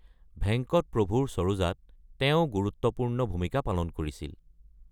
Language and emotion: Assamese, neutral